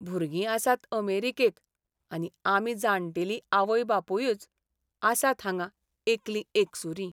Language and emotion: Goan Konkani, sad